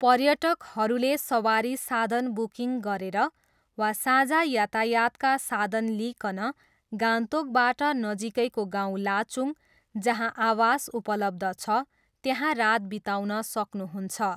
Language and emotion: Nepali, neutral